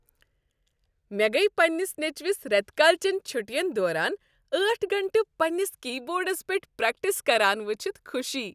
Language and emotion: Kashmiri, happy